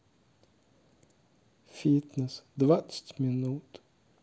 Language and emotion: Russian, sad